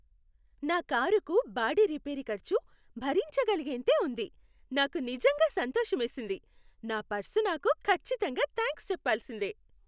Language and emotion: Telugu, happy